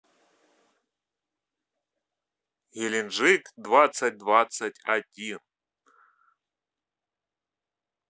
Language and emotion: Russian, positive